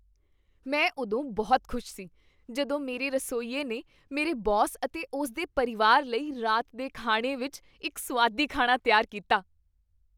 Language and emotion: Punjabi, happy